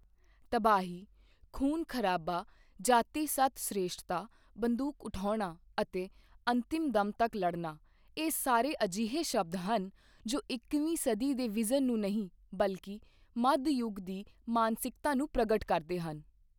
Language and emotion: Punjabi, neutral